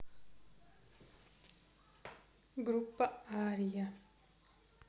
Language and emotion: Russian, neutral